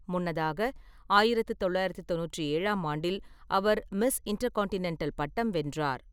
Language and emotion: Tamil, neutral